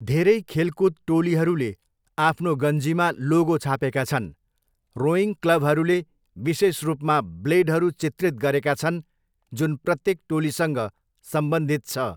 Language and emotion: Nepali, neutral